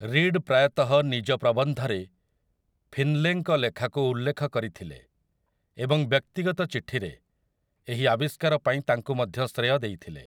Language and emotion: Odia, neutral